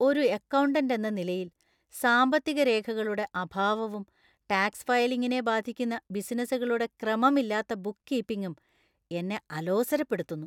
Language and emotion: Malayalam, disgusted